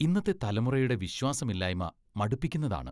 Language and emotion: Malayalam, disgusted